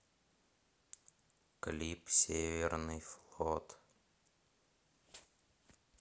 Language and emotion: Russian, neutral